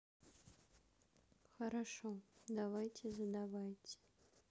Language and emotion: Russian, neutral